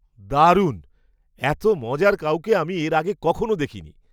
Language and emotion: Bengali, surprised